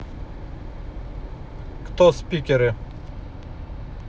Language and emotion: Russian, neutral